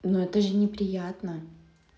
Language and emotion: Russian, neutral